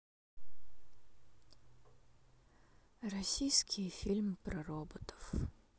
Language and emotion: Russian, sad